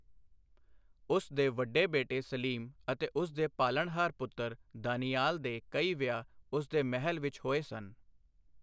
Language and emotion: Punjabi, neutral